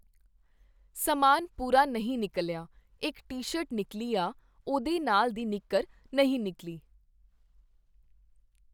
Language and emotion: Punjabi, neutral